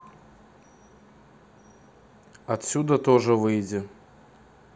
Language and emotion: Russian, neutral